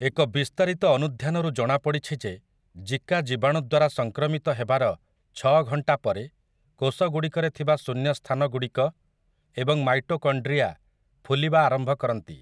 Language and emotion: Odia, neutral